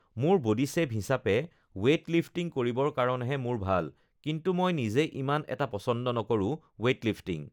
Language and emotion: Assamese, neutral